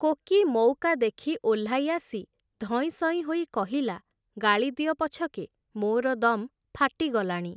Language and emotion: Odia, neutral